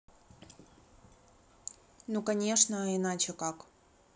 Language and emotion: Russian, neutral